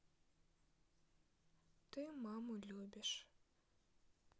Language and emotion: Russian, sad